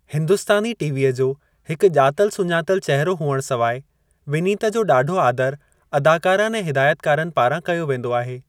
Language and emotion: Sindhi, neutral